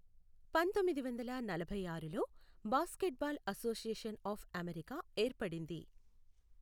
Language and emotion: Telugu, neutral